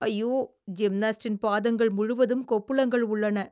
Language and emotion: Tamil, disgusted